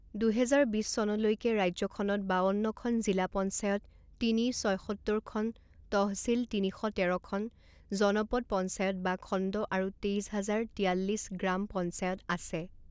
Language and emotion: Assamese, neutral